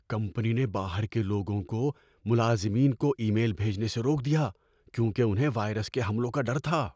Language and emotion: Urdu, fearful